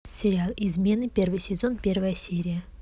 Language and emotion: Russian, neutral